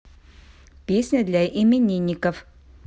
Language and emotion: Russian, neutral